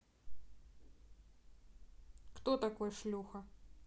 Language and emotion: Russian, neutral